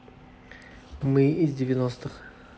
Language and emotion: Russian, neutral